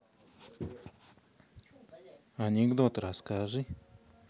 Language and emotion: Russian, neutral